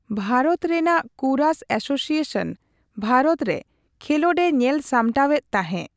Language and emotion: Santali, neutral